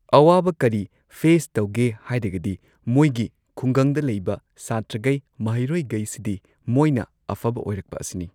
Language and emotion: Manipuri, neutral